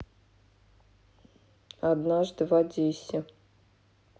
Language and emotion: Russian, neutral